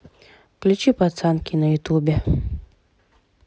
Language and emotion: Russian, neutral